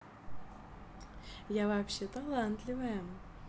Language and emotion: Russian, positive